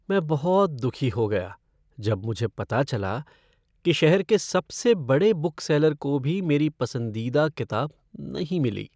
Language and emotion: Hindi, sad